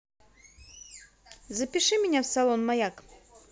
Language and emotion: Russian, positive